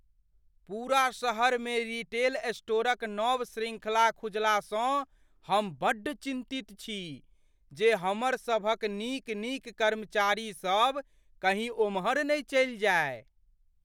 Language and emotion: Maithili, fearful